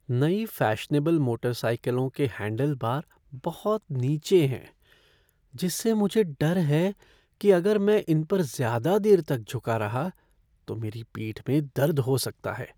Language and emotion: Hindi, fearful